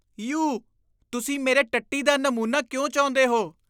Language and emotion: Punjabi, disgusted